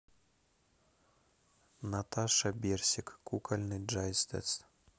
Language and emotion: Russian, neutral